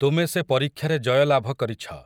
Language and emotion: Odia, neutral